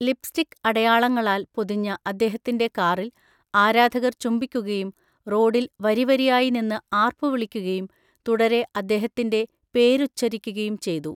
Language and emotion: Malayalam, neutral